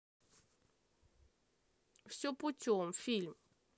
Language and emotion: Russian, neutral